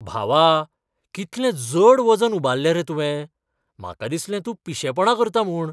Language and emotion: Goan Konkani, surprised